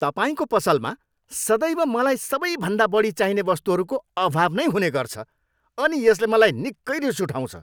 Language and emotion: Nepali, angry